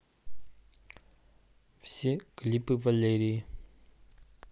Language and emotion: Russian, neutral